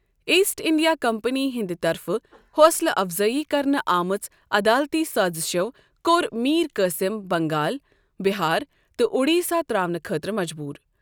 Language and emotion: Kashmiri, neutral